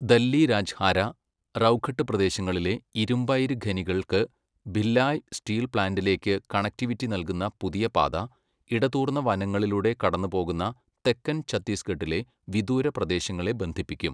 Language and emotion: Malayalam, neutral